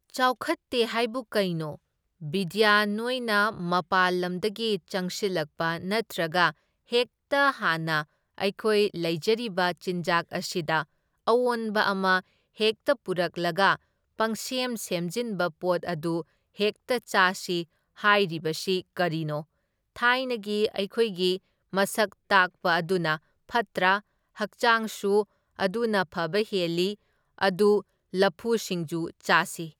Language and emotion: Manipuri, neutral